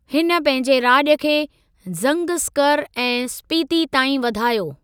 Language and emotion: Sindhi, neutral